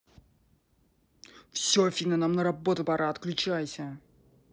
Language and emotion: Russian, angry